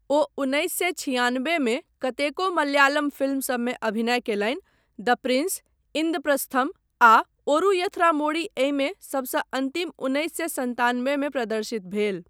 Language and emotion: Maithili, neutral